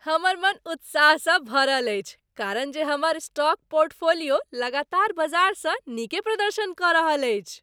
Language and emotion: Maithili, happy